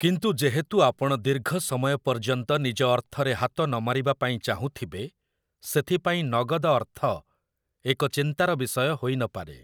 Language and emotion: Odia, neutral